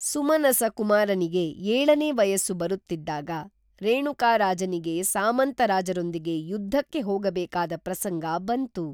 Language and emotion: Kannada, neutral